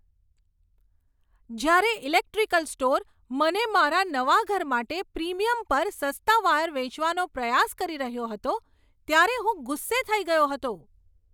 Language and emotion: Gujarati, angry